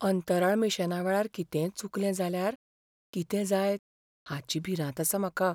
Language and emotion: Goan Konkani, fearful